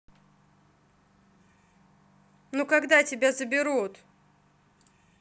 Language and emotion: Russian, angry